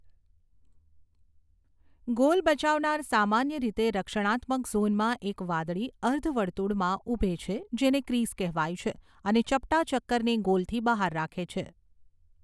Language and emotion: Gujarati, neutral